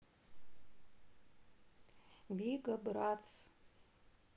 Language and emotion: Russian, neutral